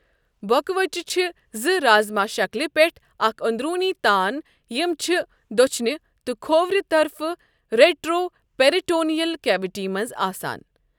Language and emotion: Kashmiri, neutral